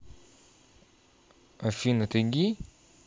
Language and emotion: Russian, neutral